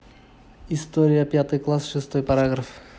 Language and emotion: Russian, neutral